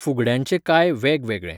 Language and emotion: Goan Konkani, neutral